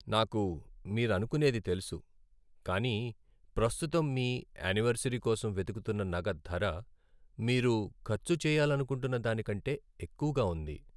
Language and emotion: Telugu, sad